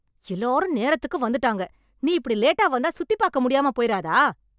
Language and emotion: Tamil, angry